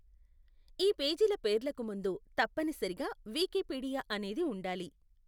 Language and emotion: Telugu, neutral